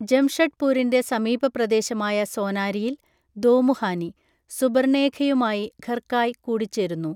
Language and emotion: Malayalam, neutral